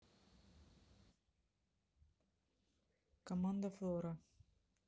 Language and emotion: Russian, neutral